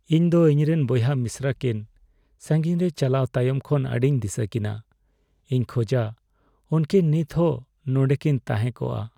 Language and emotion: Santali, sad